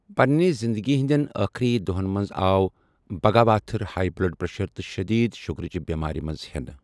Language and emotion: Kashmiri, neutral